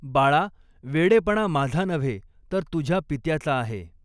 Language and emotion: Marathi, neutral